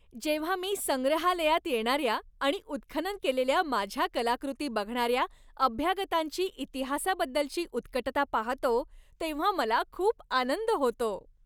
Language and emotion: Marathi, happy